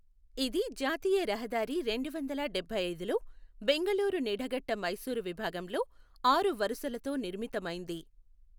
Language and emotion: Telugu, neutral